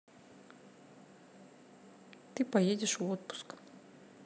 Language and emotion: Russian, neutral